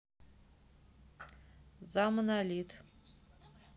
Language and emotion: Russian, neutral